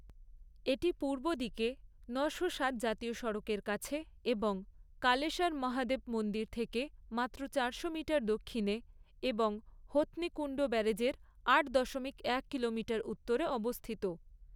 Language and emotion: Bengali, neutral